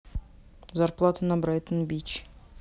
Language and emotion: Russian, neutral